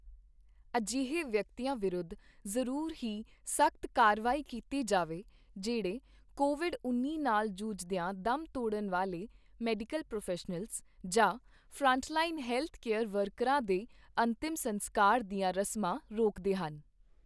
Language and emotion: Punjabi, neutral